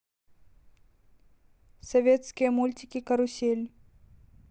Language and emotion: Russian, neutral